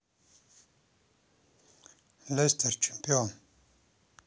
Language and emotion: Russian, neutral